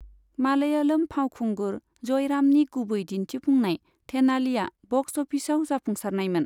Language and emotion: Bodo, neutral